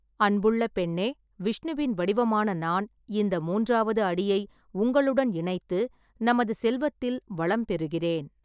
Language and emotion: Tamil, neutral